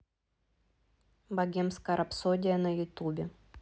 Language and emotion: Russian, neutral